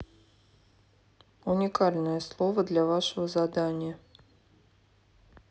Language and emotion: Russian, neutral